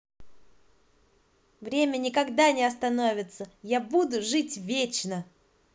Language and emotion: Russian, positive